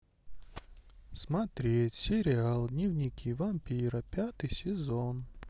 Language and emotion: Russian, neutral